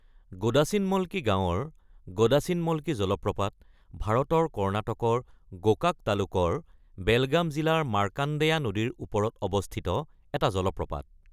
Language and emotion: Assamese, neutral